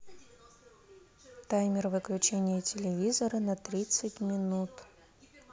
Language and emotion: Russian, neutral